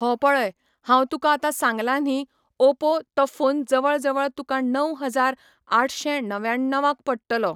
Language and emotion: Goan Konkani, neutral